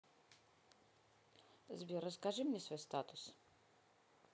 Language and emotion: Russian, neutral